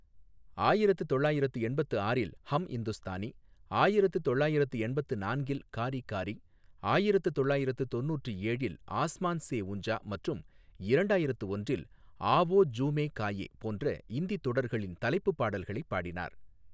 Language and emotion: Tamil, neutral